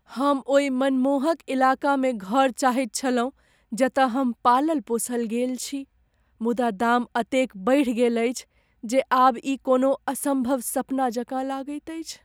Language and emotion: Maithili, sad